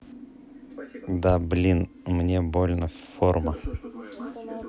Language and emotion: Russian, neutral